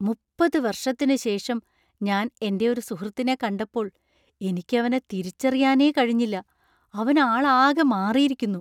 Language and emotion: Malayalam, surprised